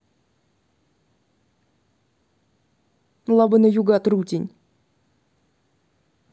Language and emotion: Russian, angry